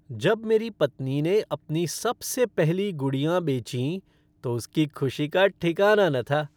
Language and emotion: Hindi, happy